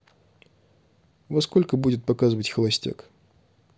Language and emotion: Russian, neutral